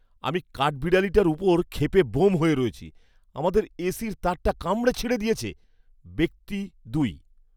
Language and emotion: Bengali, angry